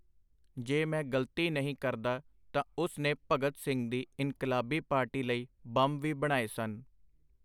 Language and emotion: Punjabi, neutral